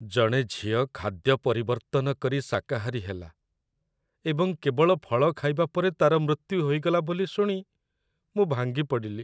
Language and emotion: Odia, sad